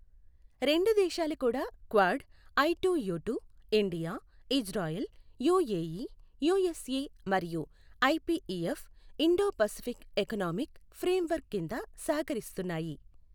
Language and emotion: Telugu, neutral